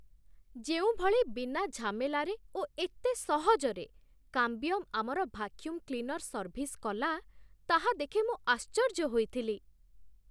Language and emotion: Odia, surprised